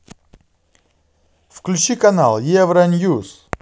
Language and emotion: Russian, positive